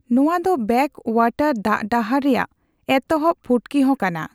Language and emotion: Santali, neutral